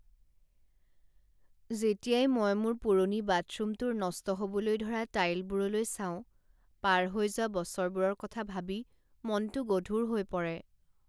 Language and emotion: Assamese, sad